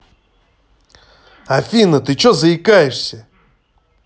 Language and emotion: Russian, angry